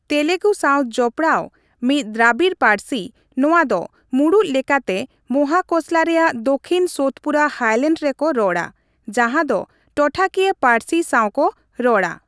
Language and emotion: Santali, neutral